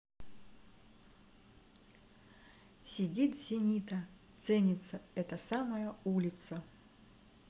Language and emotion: Russian, positive